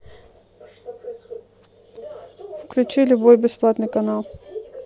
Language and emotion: Russian, neutral